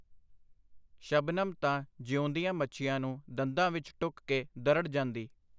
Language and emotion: Punjabi, neutral